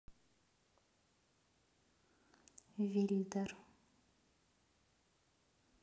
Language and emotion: Russian, neutral